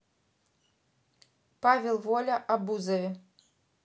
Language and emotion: Russian, neutral